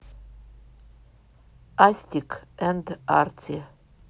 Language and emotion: Russian, neutral